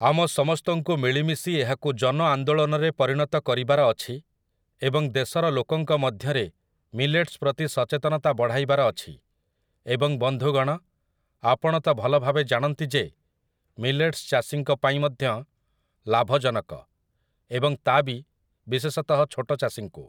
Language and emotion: Odia, neutral